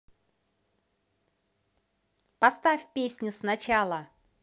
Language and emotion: Russian, positive